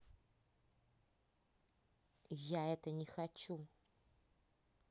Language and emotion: Russian, angry